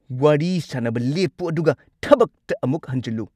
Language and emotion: Manipuri, angry